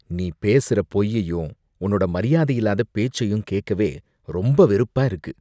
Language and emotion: Tamil, disgusted